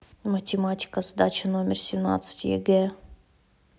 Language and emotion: Russian, neutral